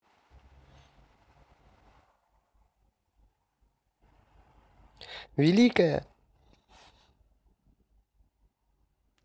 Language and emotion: Russian, positive